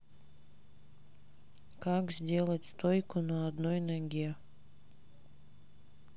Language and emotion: Russian, neutral